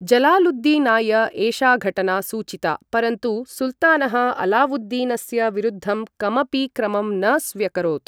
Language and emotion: Sanskrit, neutral